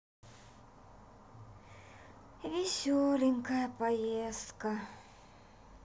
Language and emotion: Russian, sad